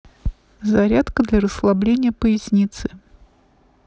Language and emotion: Russian, neutral